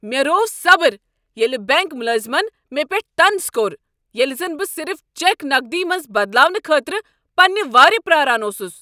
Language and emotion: Kashmiri, angry